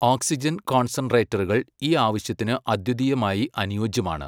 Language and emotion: Malayalam, neutral